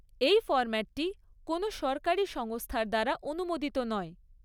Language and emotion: Bengali, neutral